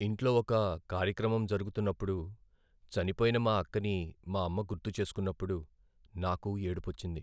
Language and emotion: Telugu, sad